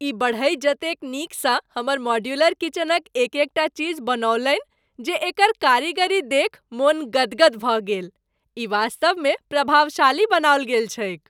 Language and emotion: Maithili, happy